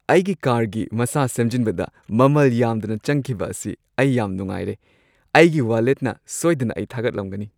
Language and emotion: Manipuri, happy